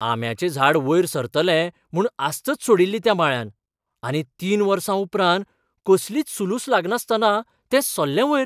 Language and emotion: Goan Konkani, surprised